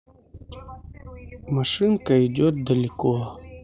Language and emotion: Russian, neutral